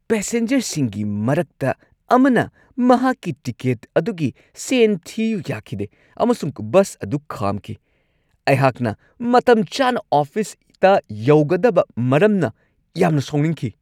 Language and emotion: Manipuri, angry